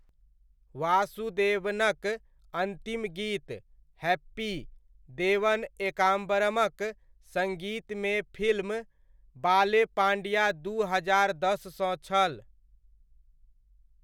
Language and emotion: Maithili, neutral